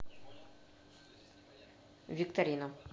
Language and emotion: Russian, neutral